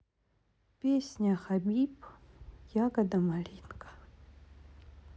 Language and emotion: Russian, sad